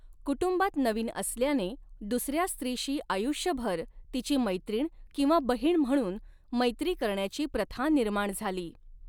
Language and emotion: Marathi, neutral